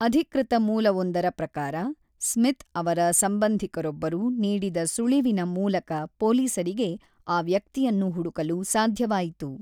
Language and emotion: Kannada, neutral